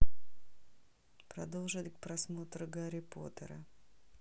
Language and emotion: Russian, neutral